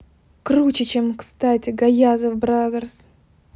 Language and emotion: Russian, positive